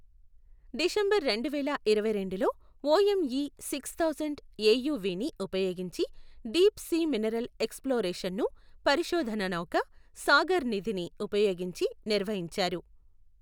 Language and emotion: Telugu, neutral